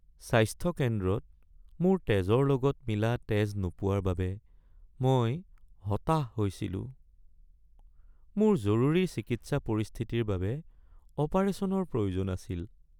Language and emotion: Assamese, sad